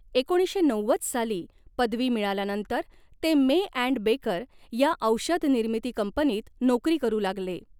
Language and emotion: Marathi, neutral